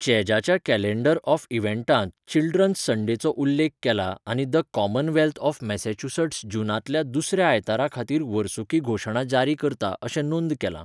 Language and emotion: Goan Konkani, neutral